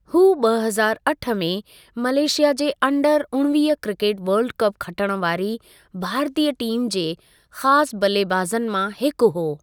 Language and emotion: Sindhi, neutral